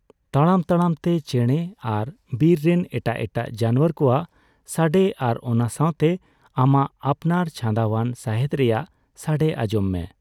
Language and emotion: Santali, neutral